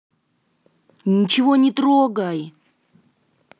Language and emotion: Russian, angry